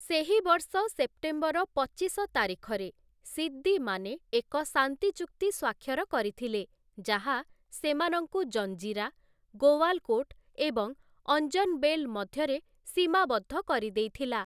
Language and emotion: Odia, neutral